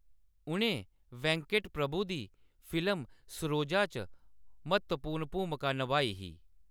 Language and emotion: Dogri, neutral